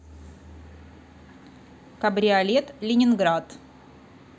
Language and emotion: Russian, neutral